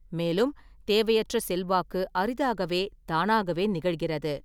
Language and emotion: Tamil, neutral